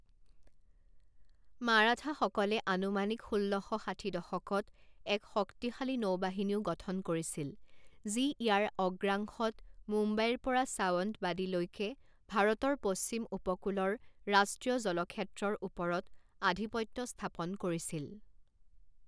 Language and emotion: Assamese, neutral